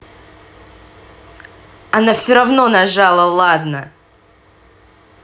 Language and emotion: Russian, angry